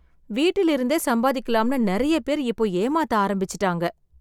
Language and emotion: Tamil, sad